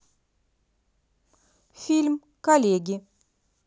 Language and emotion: Russian, neutral